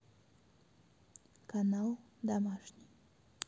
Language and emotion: Russian, neutral